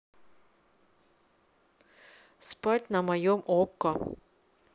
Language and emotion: Russian, neutral